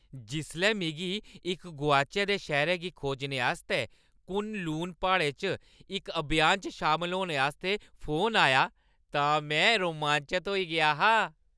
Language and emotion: Dogri, happy